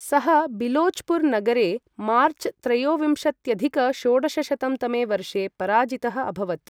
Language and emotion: Sanskrit, neutral